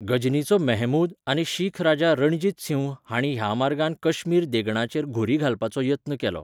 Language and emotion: Goan Konkani, neutral